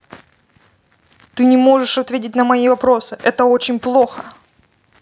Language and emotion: Russian, angry